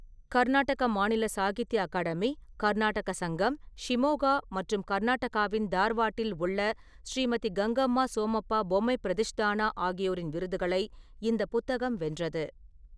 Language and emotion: Tamil, neutral